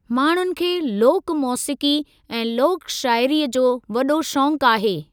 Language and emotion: Sindhi, neutral